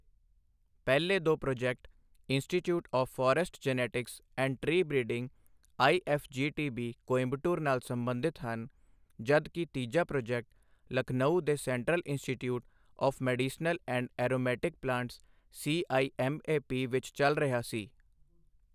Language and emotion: Punjabi, neutral